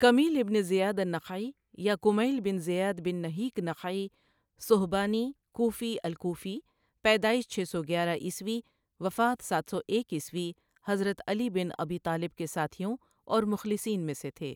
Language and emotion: Urdu, neutral